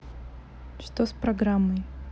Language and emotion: Russian, neutral